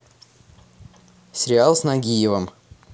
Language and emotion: Russian, neutral